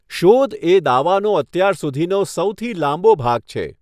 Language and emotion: Gujarati, neutral